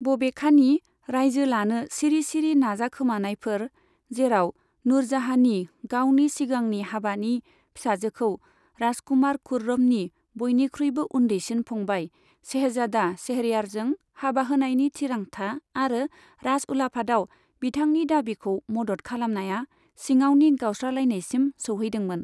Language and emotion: Bodo, neutral